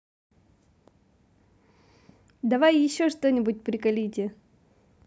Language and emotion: Russian, positive